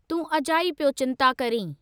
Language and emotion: Sindhi, neutral